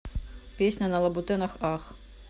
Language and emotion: Russian, neutral